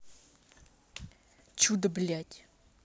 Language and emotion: Russian, angry